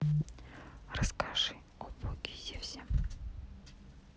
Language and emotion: Russian, neutral